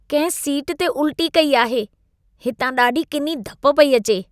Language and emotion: Sindhi, disgusted